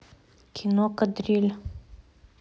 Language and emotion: Russian, neutral